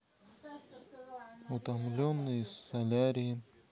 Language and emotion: Russian, neutral